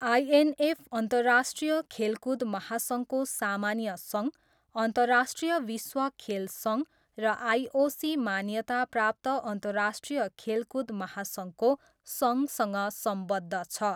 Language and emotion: Nepali, neutral